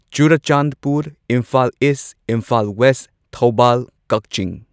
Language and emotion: Manipuri, neutral